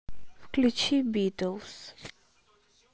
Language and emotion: Russian, neutral